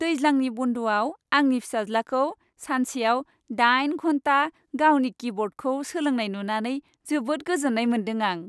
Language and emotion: Bodo, happy